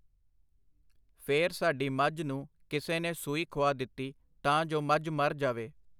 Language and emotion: Punjabi, neutral